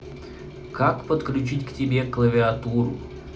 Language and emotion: Russian, neutral